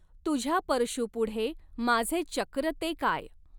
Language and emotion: Marathi, neutral